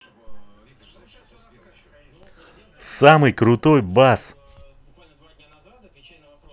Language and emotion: Russian, neutral